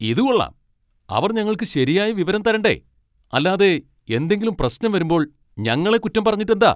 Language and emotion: Malayalam, angry